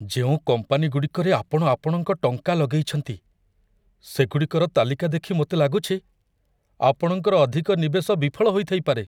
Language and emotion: Odia, fearful